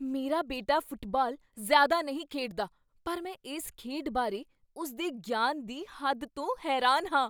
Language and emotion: Punjabi, surprised